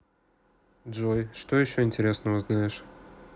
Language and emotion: Russian, neutral